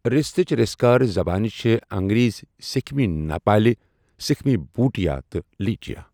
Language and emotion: Kashmiri, neutral